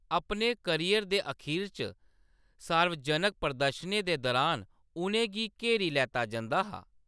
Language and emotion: Dogri, neutral